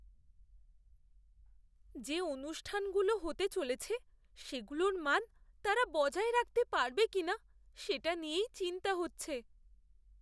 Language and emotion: Bengali, fearful